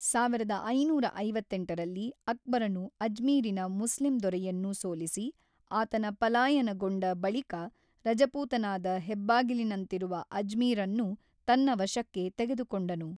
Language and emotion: Kannada, neutral